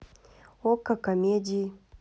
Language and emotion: Russian, neutral